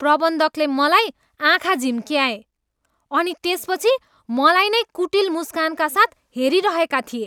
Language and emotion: Nepali, disgusted